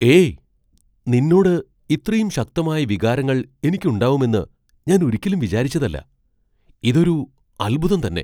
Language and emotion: Malayalam, surprised